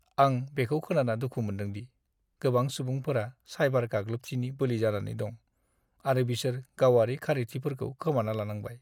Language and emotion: Bodo, sad